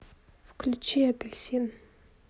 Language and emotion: Russian, neutral